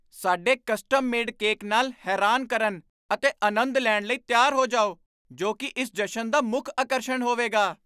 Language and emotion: Punjabi, surprised